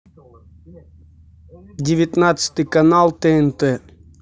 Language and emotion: Russian, neutral